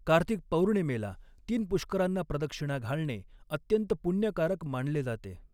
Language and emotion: Marathi, neutral